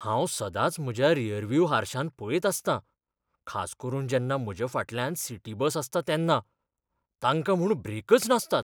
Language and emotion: Goan Konkani, fearful